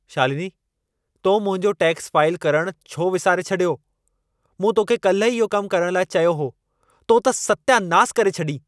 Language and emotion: Sindhi, angry